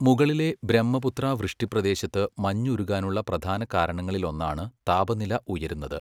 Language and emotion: Malayalam, neutral